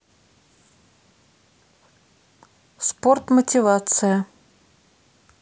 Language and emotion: Russian, neutral